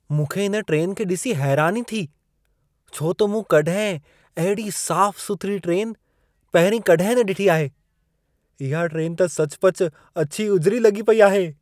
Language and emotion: Sindhi, surprised